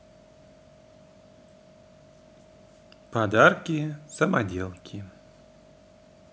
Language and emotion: Russian, neutral